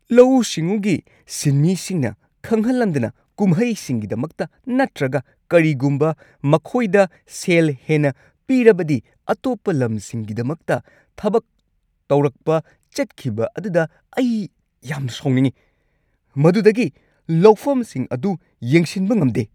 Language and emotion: Manipuri, angry